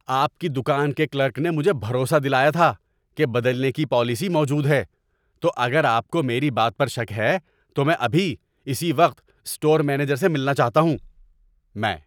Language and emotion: Urdu, angry